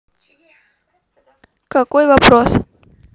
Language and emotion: Russian, neutral